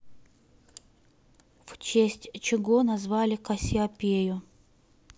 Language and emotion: Russian, neutral